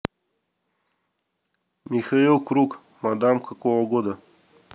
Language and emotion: Russian, neutral